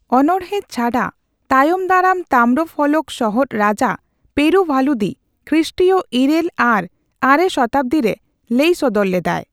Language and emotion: Santali, neutral